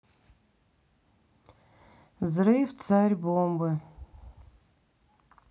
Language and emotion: Russian, sad